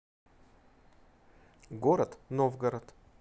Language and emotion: Russian, neutral